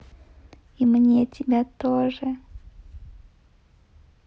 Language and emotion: Russian, positive